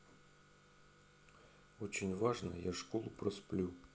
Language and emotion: Russian, neutral